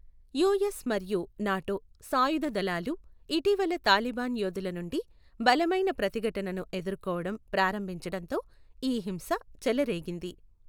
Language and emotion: Telugu, neutral